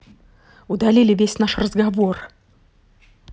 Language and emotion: Russian, angry